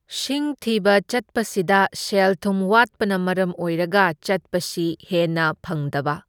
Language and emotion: Manipuri, neutral